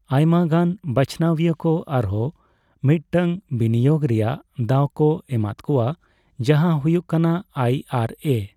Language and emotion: Santali, neutral